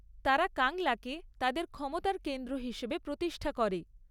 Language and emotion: Bengali, neutral